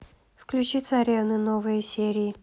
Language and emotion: Russian, neutral